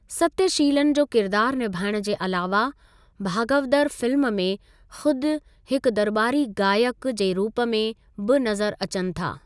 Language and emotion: Sindhi, neutral